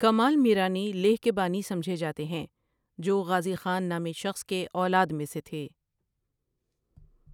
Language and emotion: Urdu, neutral